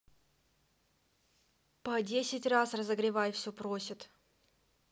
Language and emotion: Russian, angry